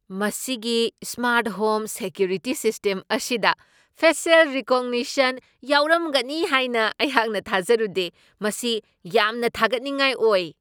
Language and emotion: Manipuri, surprised